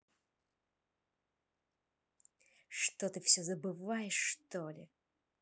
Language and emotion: Russian, angry